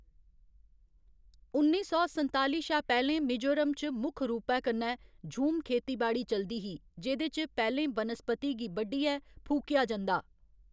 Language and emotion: Dogri, neutral